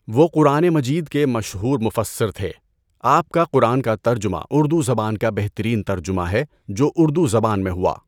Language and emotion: Urdu, neutral